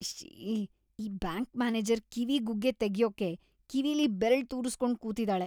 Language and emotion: Kannada, disgusted